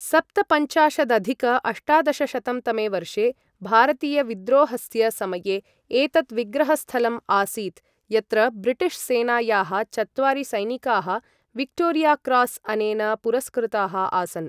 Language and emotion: Sanskrit, neutral